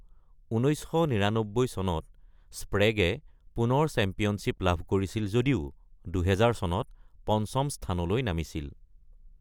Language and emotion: Assamese, neutral